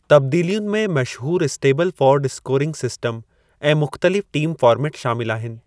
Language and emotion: Sindhi, neutral